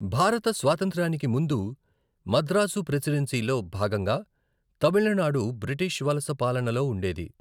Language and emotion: Telugu, neutral